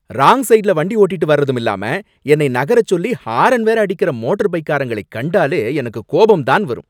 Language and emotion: Tamil, angry